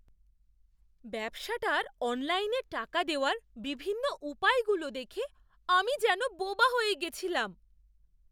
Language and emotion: Bengali, surprised